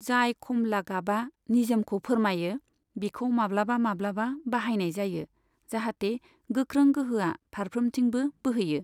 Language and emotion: Bodo, neutral